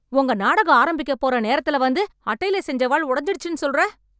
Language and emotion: Tamil, angry